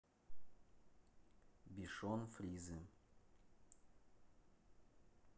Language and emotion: Russian, neutral